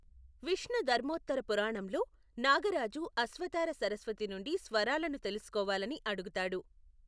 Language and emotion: Telugu, neutral